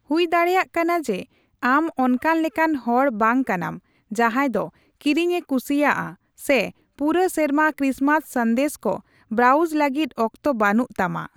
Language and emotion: Santali, neutral